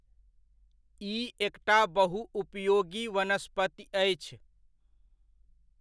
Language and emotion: Maithili, neutral